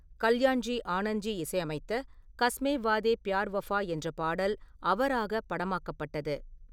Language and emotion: Tamil, neutral